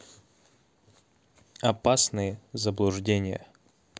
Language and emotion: Russian, neutral